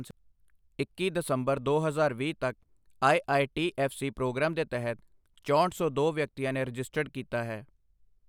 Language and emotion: Punjabi, neutral